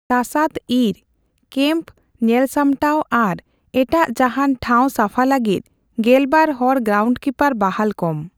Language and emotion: Santali, neutral